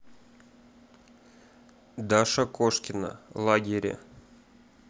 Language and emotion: Russian, neutral